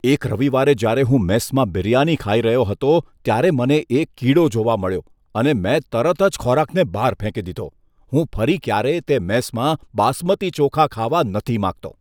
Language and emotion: Gujarati, disgusted